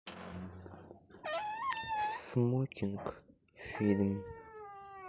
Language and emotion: Russian, sad